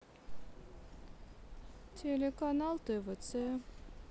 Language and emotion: Russian, sad